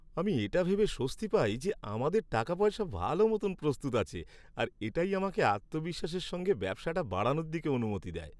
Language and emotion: Bengali, happy